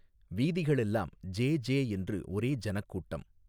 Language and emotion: Tamil, neutral